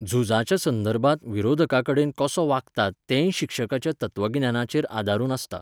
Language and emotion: Goan Konkani, neutral